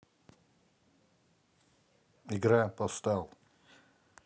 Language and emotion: Russian, neutral